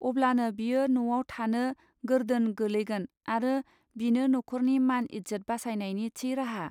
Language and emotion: Bodo, neutral